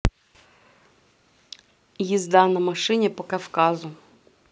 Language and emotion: Russian, neutral